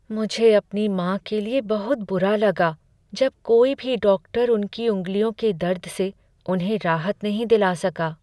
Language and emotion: Hindi, sad